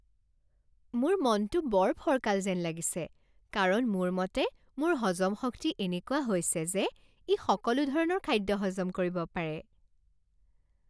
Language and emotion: Assamese, happy